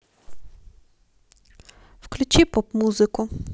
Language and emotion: Russian, neutral